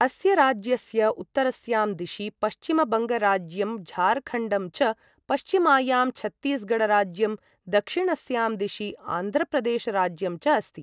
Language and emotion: Sanskrit, neutral